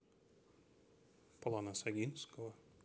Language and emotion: Russian, neutral